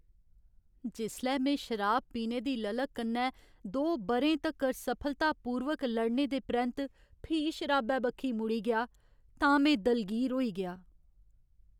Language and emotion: Dogri, sad